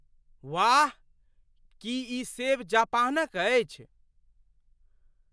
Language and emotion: Maithili, surprised